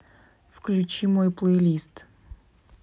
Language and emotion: Russian, angry